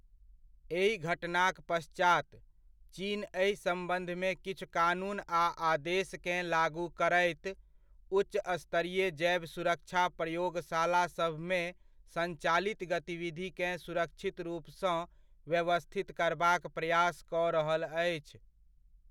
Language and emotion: Maithili, neutral